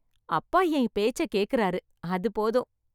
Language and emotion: Tamil, happy